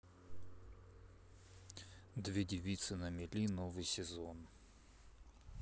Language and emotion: Russian, neutral